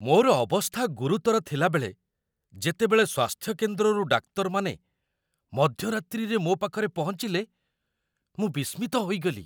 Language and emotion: Odia, surprised